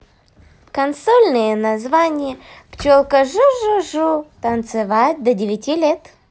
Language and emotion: Russian, positive